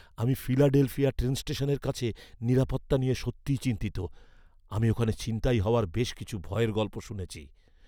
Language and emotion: Bengali, fearful